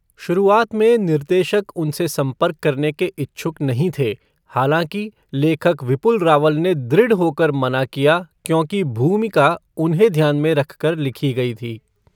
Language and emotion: Hindi, neutral